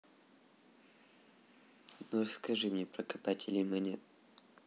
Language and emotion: Russian, neutral